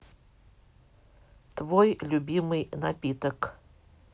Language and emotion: Russian, neutral